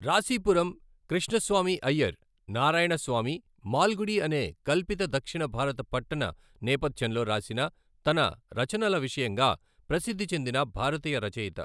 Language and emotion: Telugu, neutral